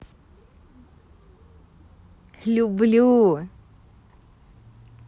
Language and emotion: Russian, positive